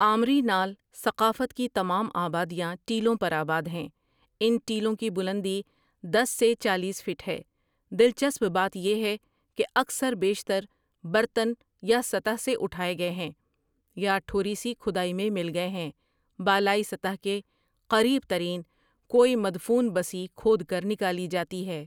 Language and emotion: Urdu, neutral